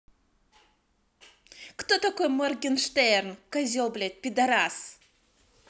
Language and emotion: Russian, angry